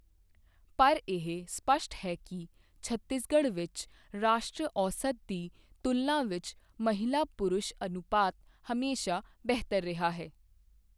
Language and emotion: Punjabi, neutral